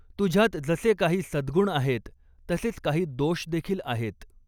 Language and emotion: Marathi, neutral